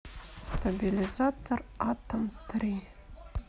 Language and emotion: Russian, neutral